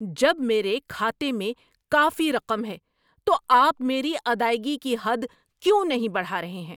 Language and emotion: Urdu, angry